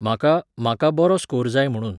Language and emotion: Goan Konkani, neutral